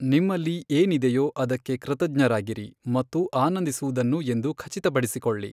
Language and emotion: Kannada, neutral